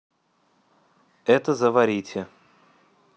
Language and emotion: Russian, neutral